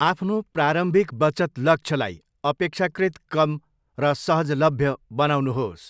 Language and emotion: Nepali, neutral